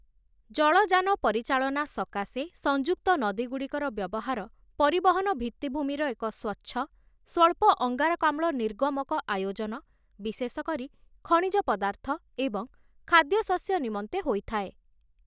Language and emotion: Odia, neutral